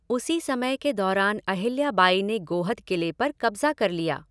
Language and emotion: Hindi, neutral